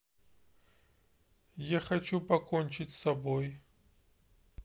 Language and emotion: Russian, sad